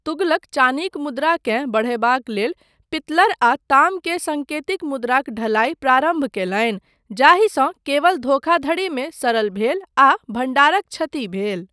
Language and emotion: Maithili, neutral